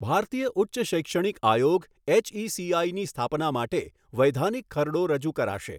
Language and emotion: Gujarati, neutral